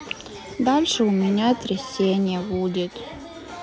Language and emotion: Russian, sad